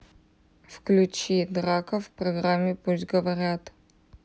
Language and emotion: Russian, neutral